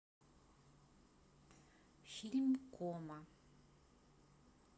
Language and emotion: Russian, neutral